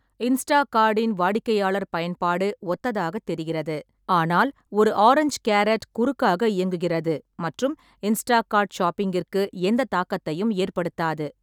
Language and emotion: Tamil, neutral